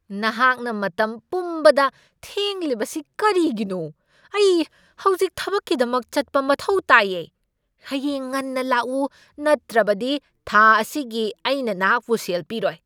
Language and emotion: Manipuri, angry